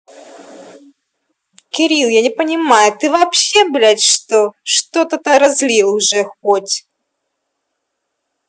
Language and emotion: Russian, angry